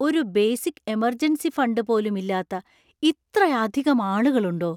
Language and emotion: Malayalam, surprised